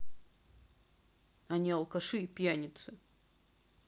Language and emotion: Russian, neutral